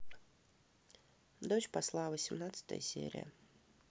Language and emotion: Russian, neutral